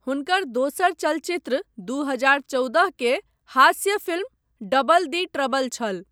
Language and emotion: Maithili, neutral